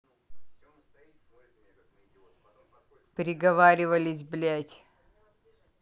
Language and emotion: Russian, angry